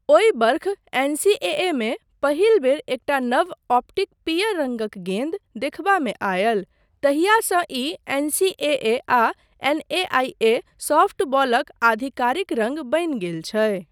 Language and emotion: Maithili, neutral